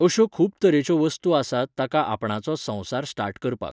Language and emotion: Goan Konkani, neutral